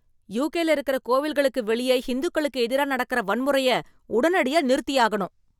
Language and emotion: Tamil, angry